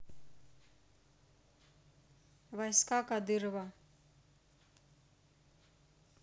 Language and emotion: Russian, neutral